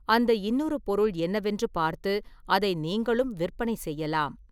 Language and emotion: Tamil, neutral